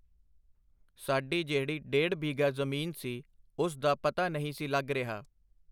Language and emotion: Punjabi, neutral